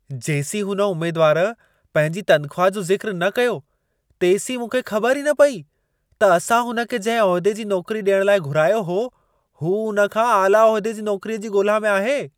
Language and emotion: Sindhi, surprised